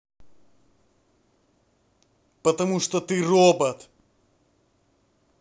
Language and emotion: Russian, angry